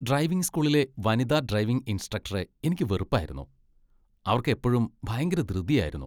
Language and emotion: Malayalam, disgusted